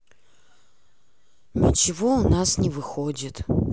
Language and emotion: Russian, sad